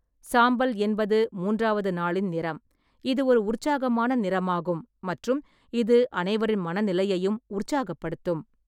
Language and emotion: Tamil, neutral